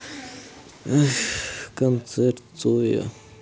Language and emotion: Russian, sad